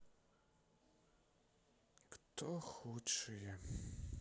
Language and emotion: Russian, sad